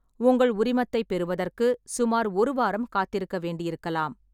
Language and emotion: Tamil, neutral